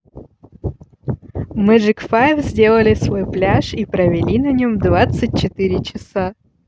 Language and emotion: Russian, positive